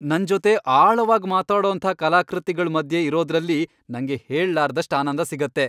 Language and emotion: Kannada, happy